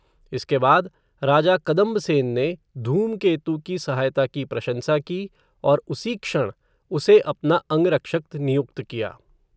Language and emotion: Hindi, neutral